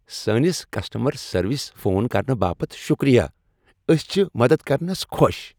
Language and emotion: Kashmiri, happy